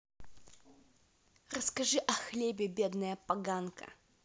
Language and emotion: Russian, angry